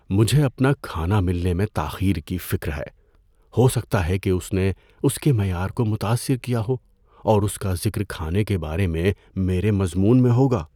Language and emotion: Urdu, fearful